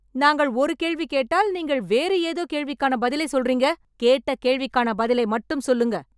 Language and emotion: Tamil, angry